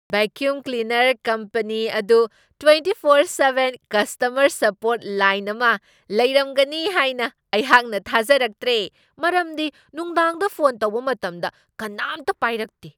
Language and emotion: Manipuri, surprised